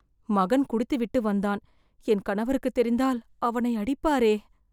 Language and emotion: Tamil, fearful